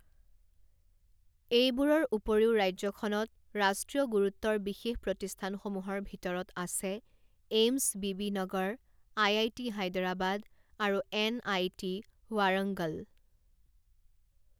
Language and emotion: Assamese, neutral